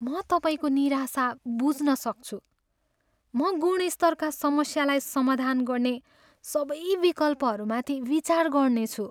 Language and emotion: Nepali, sad